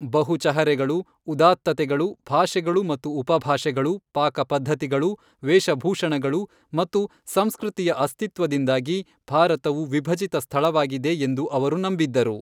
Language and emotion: Kannada, neutral